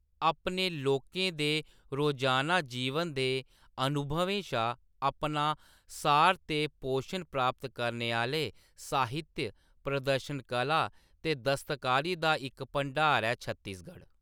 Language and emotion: Dogri, neutral